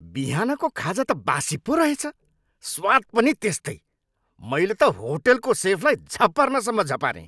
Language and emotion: Nepali, angry